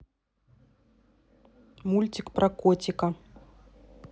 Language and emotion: Russian, neutral